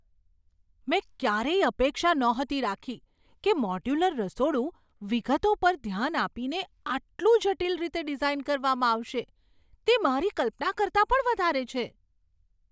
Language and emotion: Gujarati, surprised